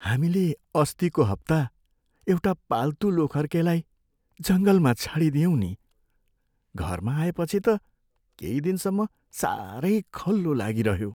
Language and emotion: Nepali, sad